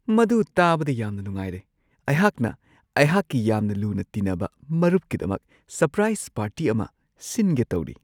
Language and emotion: Manipuri, surprised